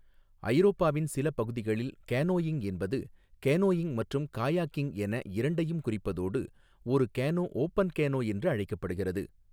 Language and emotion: Tamil, neutral